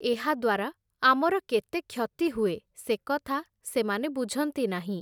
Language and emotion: Odia, neutral